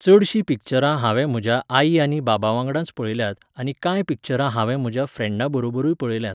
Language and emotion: Goan Konkani, neutral